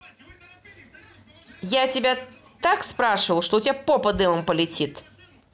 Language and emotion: Russian, angry